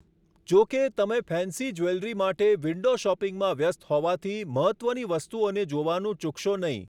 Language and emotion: Gujarati, neutral